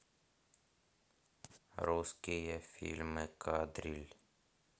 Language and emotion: Russian, neutral